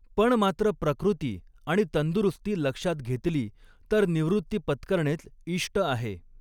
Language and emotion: Marathi, neutral